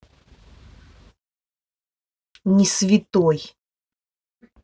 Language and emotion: Russian, angry